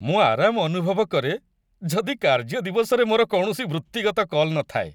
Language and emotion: Odia, happy